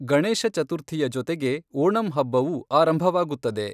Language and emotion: Kannada, neutral